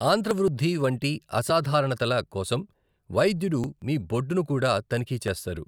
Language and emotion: Telugu, neutral